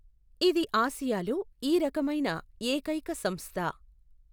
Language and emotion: Telugu, neutral